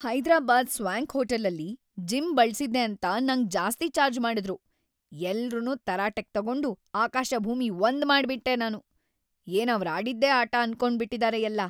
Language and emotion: Kannada, angry